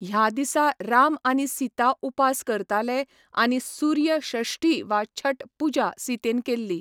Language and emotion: Goan Konkani, neutral